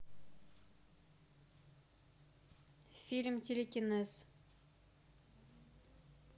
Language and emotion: Russian, neutral